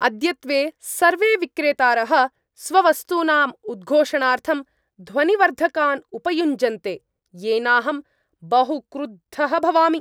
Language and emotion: Sanskrit, angry